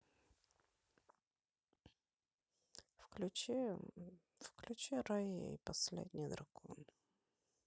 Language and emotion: Russian, sad